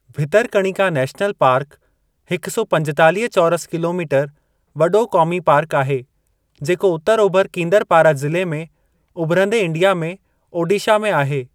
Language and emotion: Sindhi, neutral